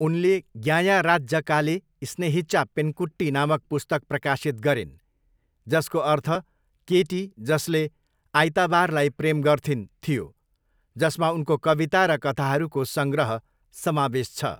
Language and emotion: Nepali, neutral